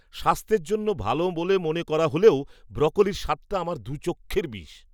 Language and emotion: Bengali, disgusted